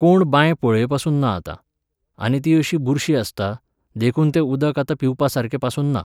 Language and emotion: Goan Konkani, neutral